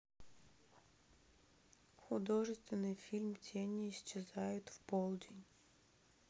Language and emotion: Russian, sad